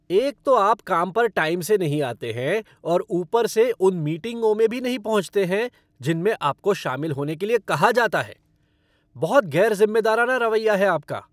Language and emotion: Hindi, angry